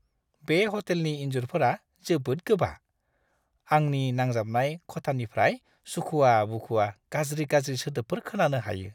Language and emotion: Bodo, disgusted